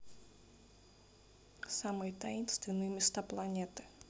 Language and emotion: Russian, neutral